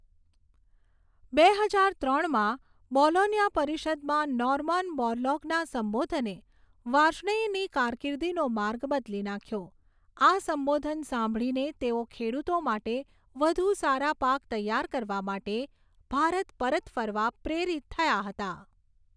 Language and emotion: Gujarati, neutral